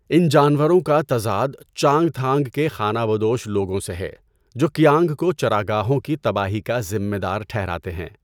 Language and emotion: Urdu, neutral